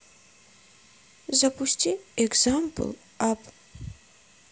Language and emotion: Russian, neutral